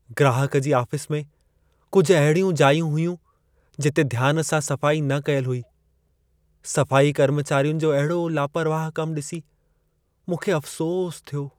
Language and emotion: Sindhi, sad